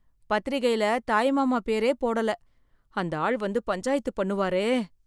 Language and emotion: Tamil, fearful